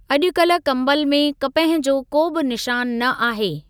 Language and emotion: Sindhi, neutral